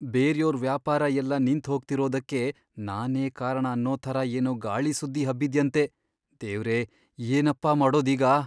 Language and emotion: Kannada, fearful